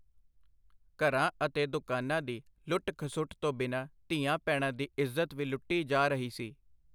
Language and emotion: Punjabi, neutral